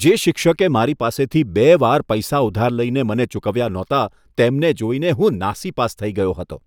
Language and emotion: Gujarati, disgusted